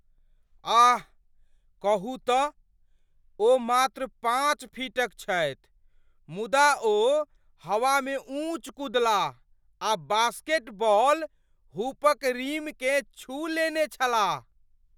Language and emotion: Maithili, surprised